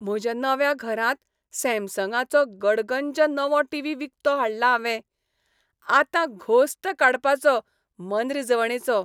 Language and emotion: Goan Konkani, happy